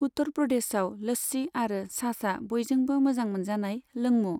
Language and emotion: Bodo, neutral